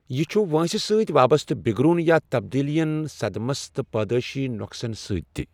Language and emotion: Kashmiri, neutral